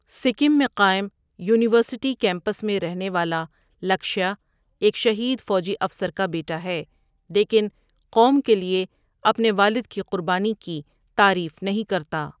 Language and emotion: Urdu, neutral